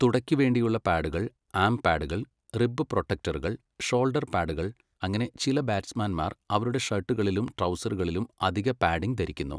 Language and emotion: Malayalam, neutral